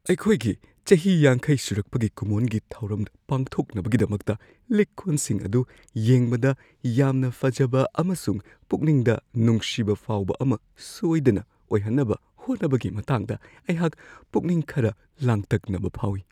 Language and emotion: Manipuri, fearful